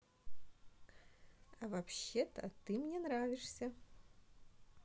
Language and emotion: Russian, positive